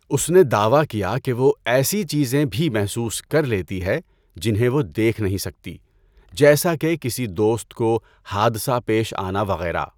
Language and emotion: Urdu, neutral